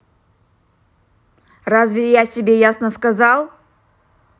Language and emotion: Russian, angry